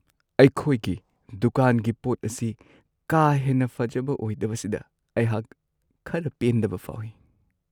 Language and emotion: Manipuri, sad